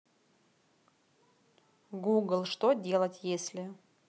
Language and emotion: Russian, neutral